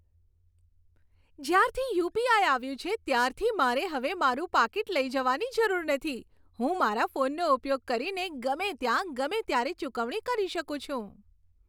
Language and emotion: Gujarati, happy